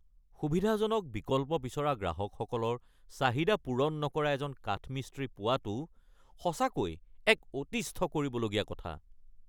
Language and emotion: Assamese, angry